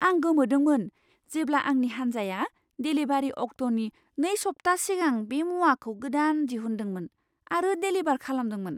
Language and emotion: Bodo, surprised